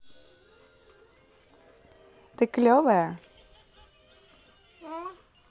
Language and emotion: Russian, positive